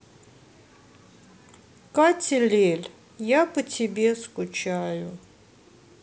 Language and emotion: Russian, sad